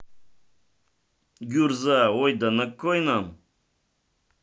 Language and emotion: Russian, neutral